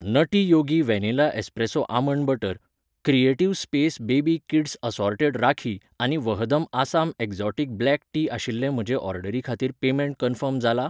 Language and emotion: Goan Konkani, neutral